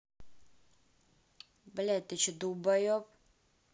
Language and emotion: Russian, angry